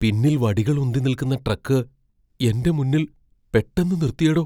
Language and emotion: Malayalam, fearful